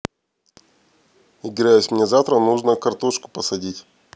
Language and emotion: Russian, neutral